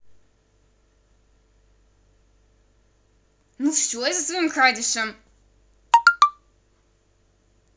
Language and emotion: Russian, angry